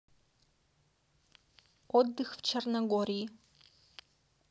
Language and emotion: Russian, neutral